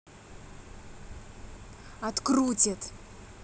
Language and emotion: Russian, angry